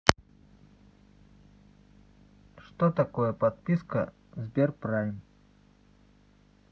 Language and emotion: Russian, neutral